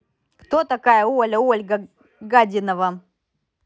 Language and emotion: Russian, angry